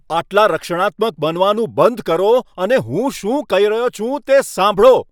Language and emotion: Gujarati, angry